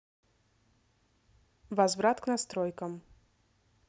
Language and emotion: Russian, neutral